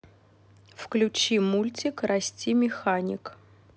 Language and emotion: Russian, neutral